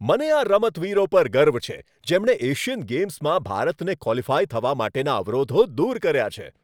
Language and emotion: Gujarati, happy